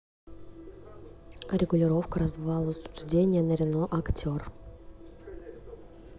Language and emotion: Russian, neutral